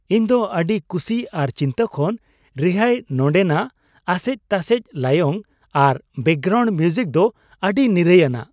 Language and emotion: Santali, happy